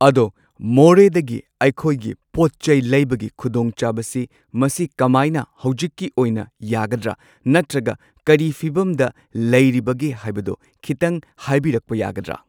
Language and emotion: Manipuri, neutral